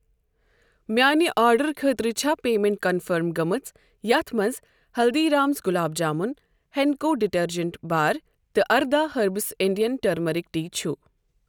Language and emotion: Kashmiri, neutral